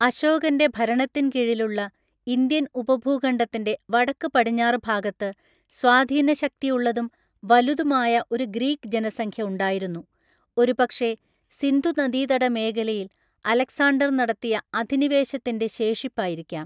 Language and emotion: Malayalam, neutral